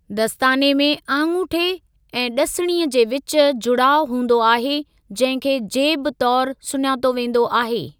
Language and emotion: Sindhi, neutral